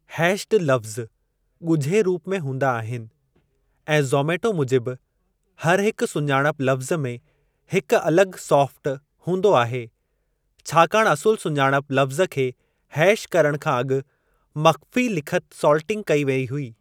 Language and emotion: Sindhi, neutral